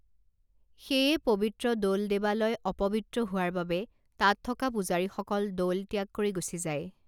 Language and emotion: Assamese, neutral